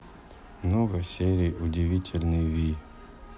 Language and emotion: Russian, neutral